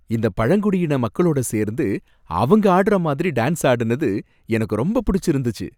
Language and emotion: Tamil, happy